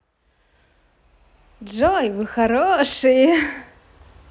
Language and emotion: Russian, positive